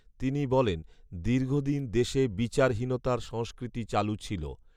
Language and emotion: Bengali, neutral